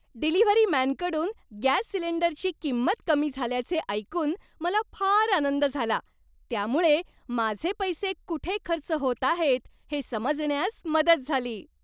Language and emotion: Marathi, happy